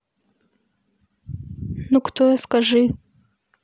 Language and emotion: Russian, neutral